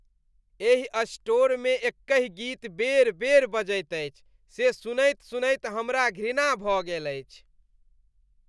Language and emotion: Maithili, disgusted